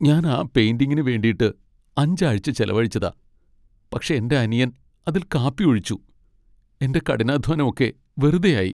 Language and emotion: Malayalam, sad